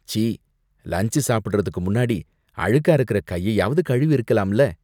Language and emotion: Tamil, disgusted